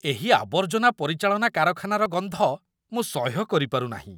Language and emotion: Odia, disgusted